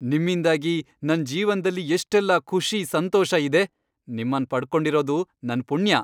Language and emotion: Kannada, happy